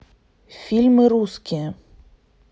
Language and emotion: Russian, neutral